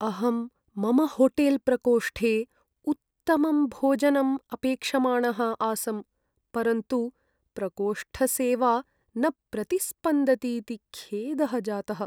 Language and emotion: Sanskrit, sad